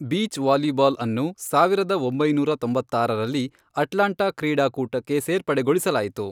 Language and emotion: Kannada, neutral